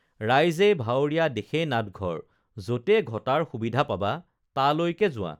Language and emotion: Assamese, neutral